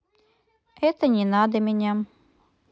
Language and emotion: Russian, neutral